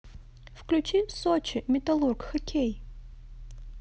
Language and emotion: Russian, positive